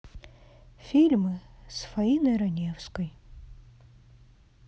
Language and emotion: Russian, sad